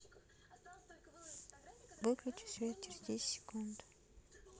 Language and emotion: Russian, neutral